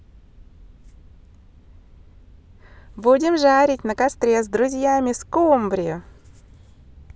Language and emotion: Russian, positive